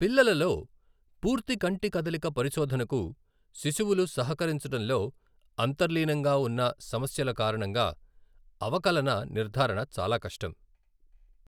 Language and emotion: Telugu, neutral